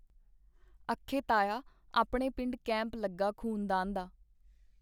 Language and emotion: Punjabi, neutral